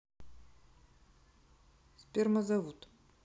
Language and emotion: Russian, neutral